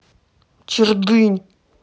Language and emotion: Russian, angry